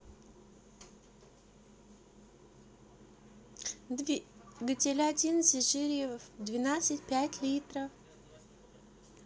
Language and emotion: Russian, neutral